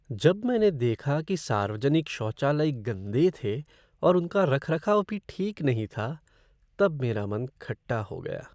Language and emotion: Hindi, sad